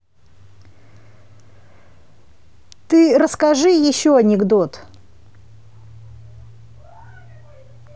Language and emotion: Russian, neutral